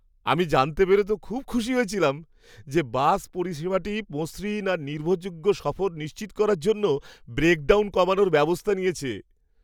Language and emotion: Bengali, happy